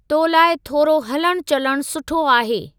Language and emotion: Sindhi, neutral